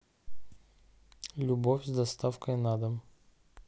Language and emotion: Russian, neutral